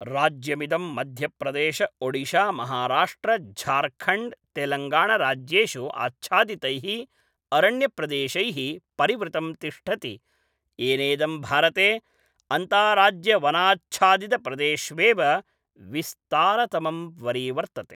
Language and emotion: Sanskrit, neutral